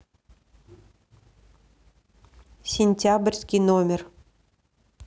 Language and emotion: Russian, neutral